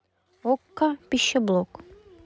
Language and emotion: Russian, neutral